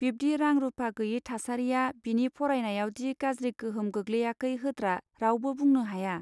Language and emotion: Bodo, neutral